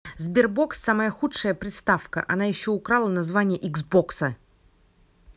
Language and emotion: Russian, angry